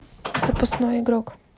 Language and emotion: Russian, neutral